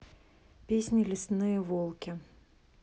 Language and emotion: Russian, neutral